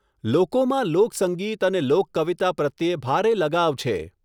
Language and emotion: Gujarati, neutral